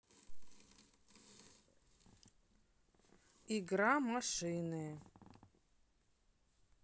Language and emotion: Russian, neutral